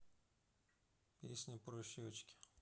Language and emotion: Russian, neutral